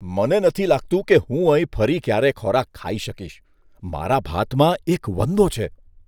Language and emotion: Gujarati, disgusted